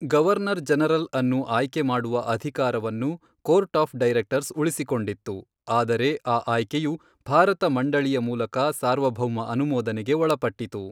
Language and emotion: Kannada, neutral